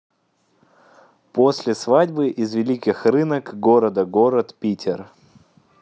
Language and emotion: Russian, positive